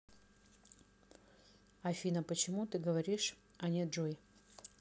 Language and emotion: Russian, neutral